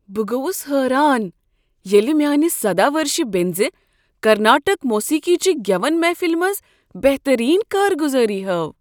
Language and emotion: Kashmiri, surprised